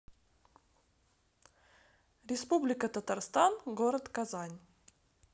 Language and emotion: Russian, neutral